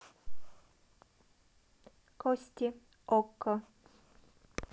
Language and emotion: Russian, neutral